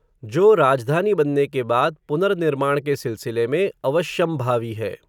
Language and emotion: Hindi, neutral